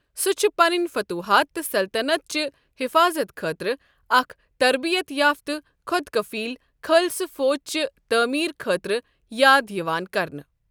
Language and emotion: Kashmiri, neutral